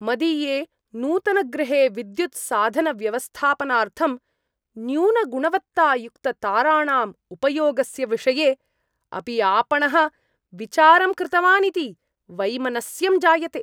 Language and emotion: Sanskrit, disgusted